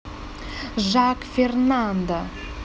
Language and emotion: Russian, neutral